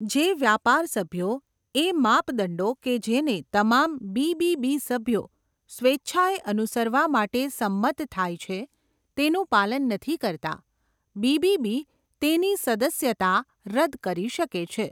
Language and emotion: Gujarati, neutral